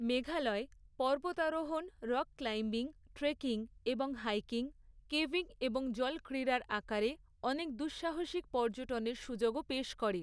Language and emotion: Bengali, neutral